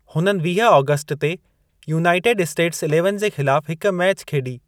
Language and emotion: Sindhi, neutral